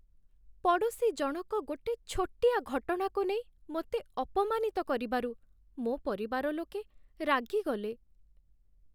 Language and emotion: Odia, sad